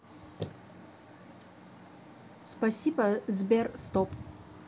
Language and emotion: Russian, neutral